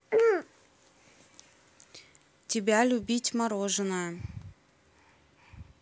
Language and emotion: Russian, neutral